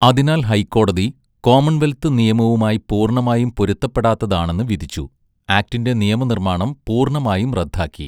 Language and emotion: Malayalam, neutral